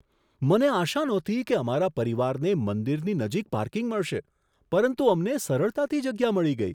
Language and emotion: Gujarati, surprised